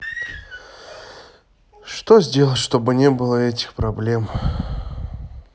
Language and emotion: Russian, sad